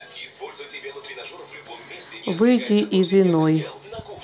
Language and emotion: Russian, neutral